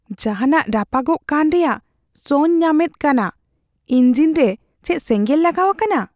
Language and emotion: Santali, fearful